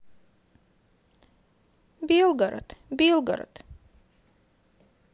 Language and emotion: Russian, sad